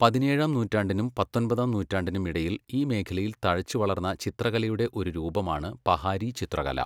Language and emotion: Malayalam, neutral